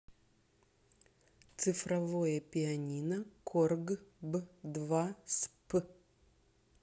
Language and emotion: Russian, neutral